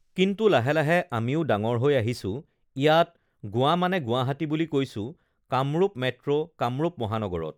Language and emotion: Assamese, neutral